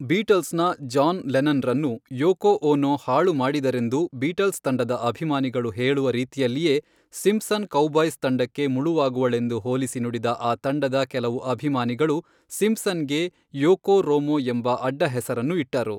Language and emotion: Kannada, neutral